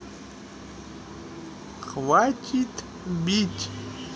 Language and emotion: Russian, neutral